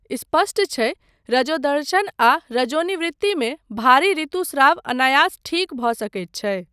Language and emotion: Maithili, neutral